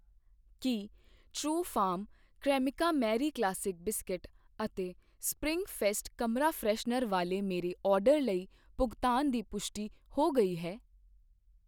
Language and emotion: Punjabi, neutral